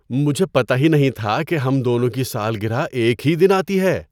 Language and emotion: Urdu, surprised